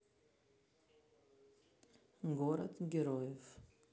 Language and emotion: Russian, neutral